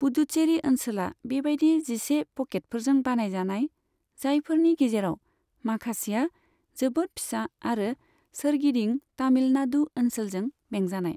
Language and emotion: Bodo, neutral